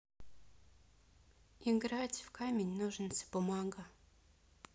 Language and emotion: Russian, sad